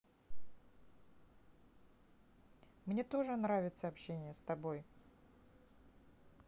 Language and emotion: Russian, neutral